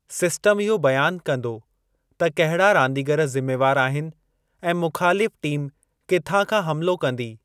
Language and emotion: Sindhi, neutral